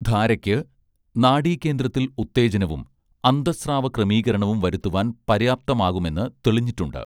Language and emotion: Malayalam, neutral